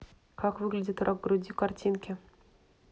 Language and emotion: Russian, neutral